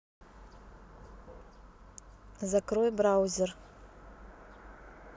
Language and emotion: Russian, neutral